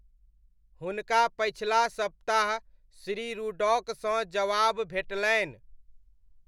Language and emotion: Maithili, neutral